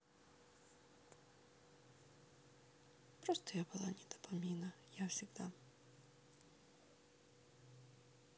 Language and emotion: Russian, sad